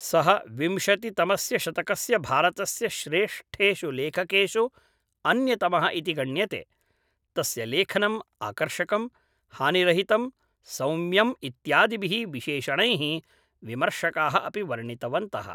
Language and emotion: Sanskrit, neutral